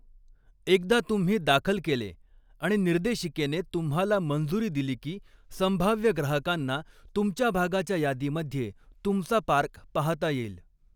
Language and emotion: Marathi, neutral